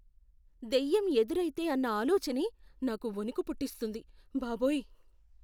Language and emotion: Telugu, fearful